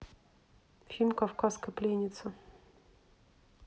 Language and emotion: Russian, neutral